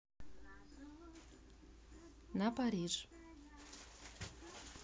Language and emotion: Russian, neutral